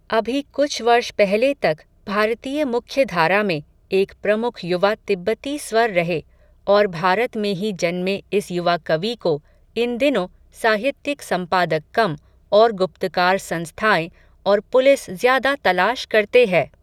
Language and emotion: Hindi, neutral